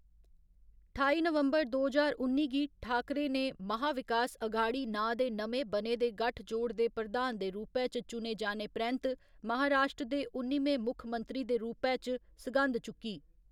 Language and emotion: Dogri, neutral